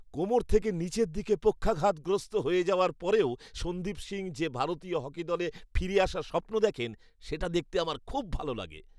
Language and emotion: Bengali, happy